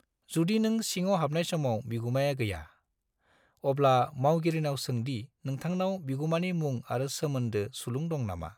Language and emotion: Bodo, neutral